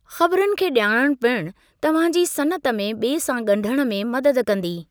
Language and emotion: Sindhi, neutral